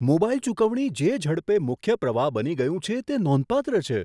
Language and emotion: Gujarati, surprised